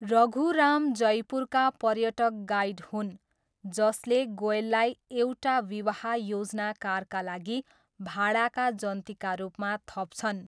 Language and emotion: Nepali, neutral